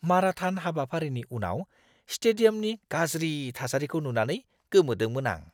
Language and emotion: Bodo, disgusted